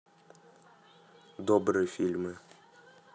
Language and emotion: Russian, neutral